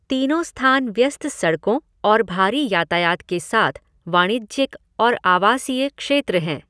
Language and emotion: Hindi, neutral